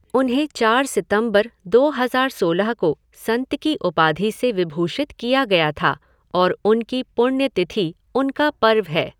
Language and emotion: Hindi, neutral